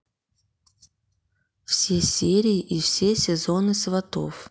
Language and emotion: Russian, neutral